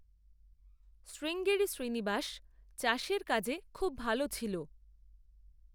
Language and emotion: Bengali, neutral